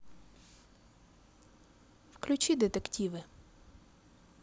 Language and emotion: Russian, positive